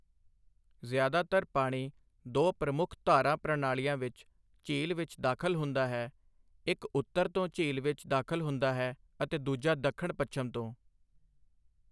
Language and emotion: Punjabi, neutral